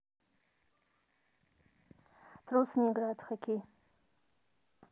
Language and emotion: Russian, neutral